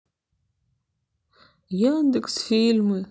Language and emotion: Russian, sad